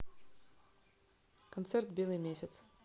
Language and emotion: Russian, neutral